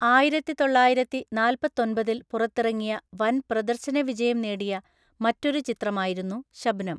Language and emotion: Malayalam, neutral